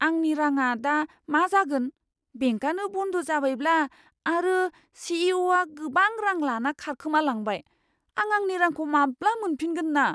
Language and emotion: Bodo, fearful